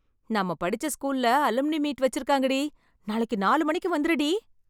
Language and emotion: Tamil, happy